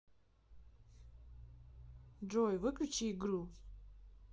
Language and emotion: Russian, neutral